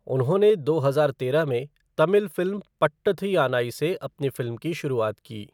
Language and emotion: Hindi, neutral